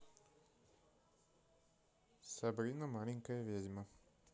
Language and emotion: Russian, neutral